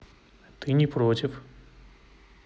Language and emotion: Russian, neutral